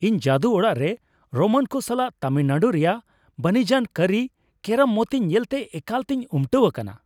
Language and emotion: Santali, happy